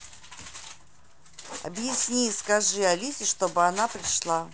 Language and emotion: Russian, angry